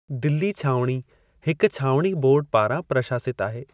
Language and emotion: Sindhi, neutral